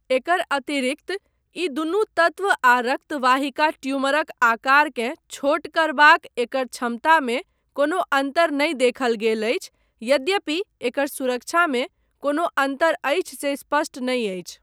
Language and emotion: Maithili, neutral